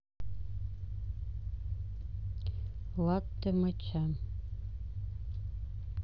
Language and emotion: Russian, neutral